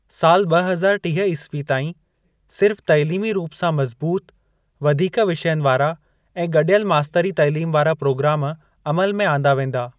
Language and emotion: Sindhi, neutral